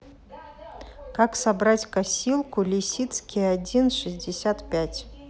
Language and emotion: Russian, neutral